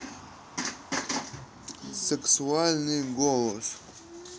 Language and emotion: Russian, neutral